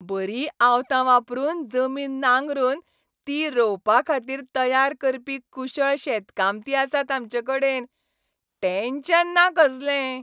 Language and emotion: Goan Konkani, happy